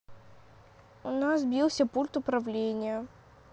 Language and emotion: Russian, sad